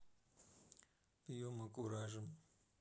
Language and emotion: Russian, neutral